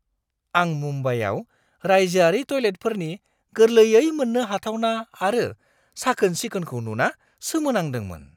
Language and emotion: Bodo, surprised